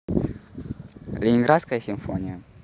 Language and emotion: Russian, neutral